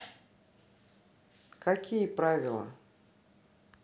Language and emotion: Russian, neutral